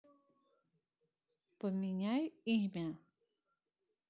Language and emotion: Russian, neutral